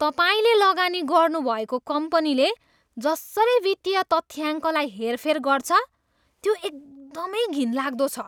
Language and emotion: Nepali, disgusted